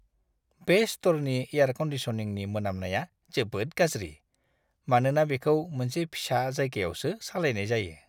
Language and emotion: Bodo, disgusted